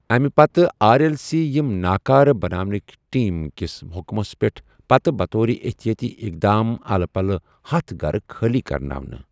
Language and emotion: Kashmiri, neutral